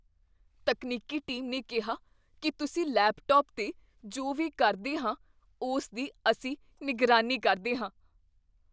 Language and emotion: Punjabi, fearful